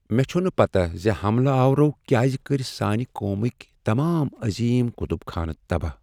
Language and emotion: Kashmiri, sad